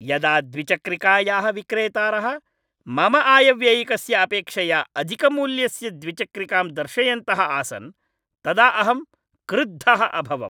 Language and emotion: Sanskrit, angry